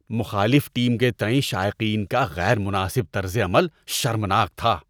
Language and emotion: Urdu, disgusted